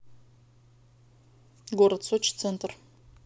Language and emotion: Russian, neutral